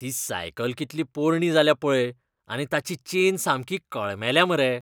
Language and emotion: Goan Konkani, disgusted